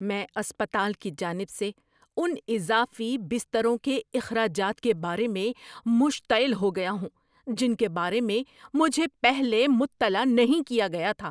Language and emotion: Urdu, angry